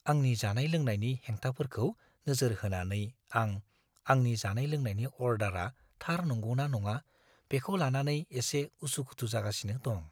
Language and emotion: Bodo, fearful